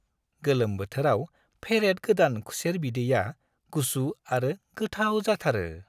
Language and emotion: Bodo, happy